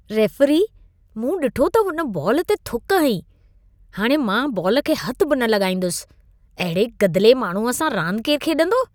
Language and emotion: Sindhi, disgusted